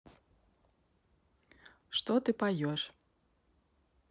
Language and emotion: Russian, neutral